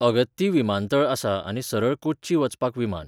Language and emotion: Goan Konkani, neutral